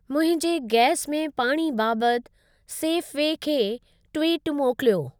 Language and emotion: Sindhi, neutral